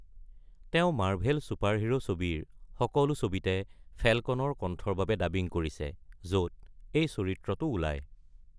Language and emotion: Assamese, neutral